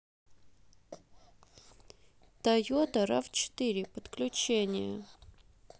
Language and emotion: Russian, neutral